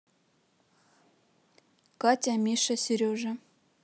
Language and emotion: Russian, neutral